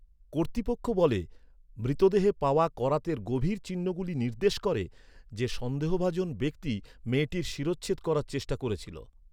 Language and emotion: Bengali, neutral